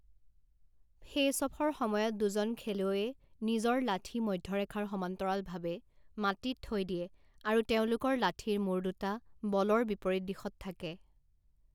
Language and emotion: Assamese, neutral